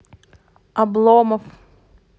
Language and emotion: Russian, neutral